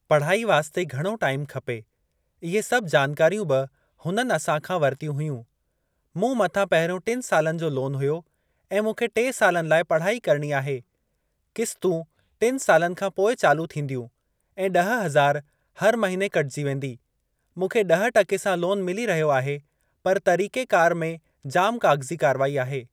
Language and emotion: Sindhi, neutral